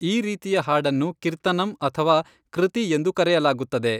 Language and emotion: Kannada, neutral